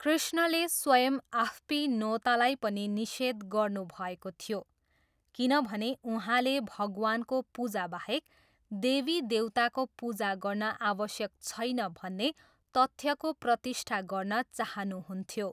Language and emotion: Nepali, neutral